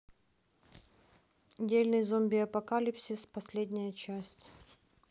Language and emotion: Russian, neutral